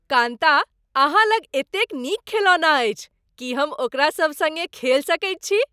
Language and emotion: Maithili, happy